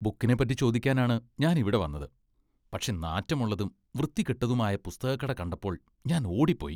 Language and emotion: Malayalam, disgusted